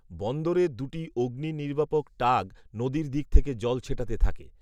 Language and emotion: Bengali, neutral